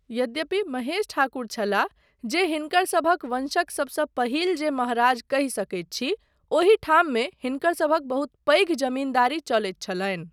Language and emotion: Maithili, neutral